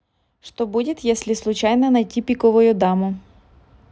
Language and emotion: Russian, neutral